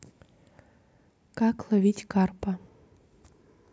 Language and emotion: Russian, neutral